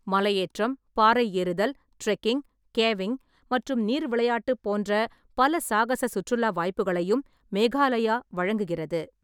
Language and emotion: Tamil, neutral